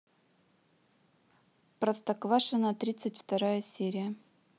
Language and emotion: Russian, neutral